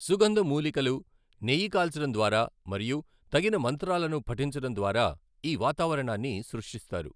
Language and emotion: Telugu, neutral